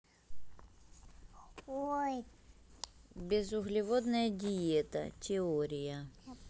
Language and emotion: Russian, neutral